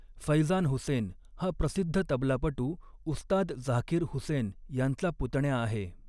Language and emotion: Marathi, neutral